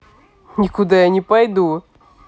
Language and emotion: Russian, neutral